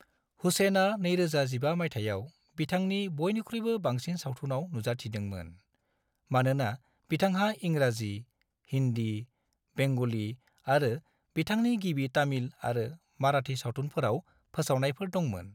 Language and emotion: Bodo, neutral